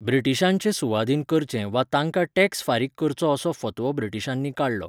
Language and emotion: Goan Konkani, neutral